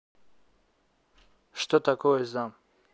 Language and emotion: Russian, neutral